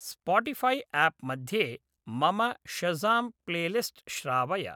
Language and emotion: Sanskrit, neutral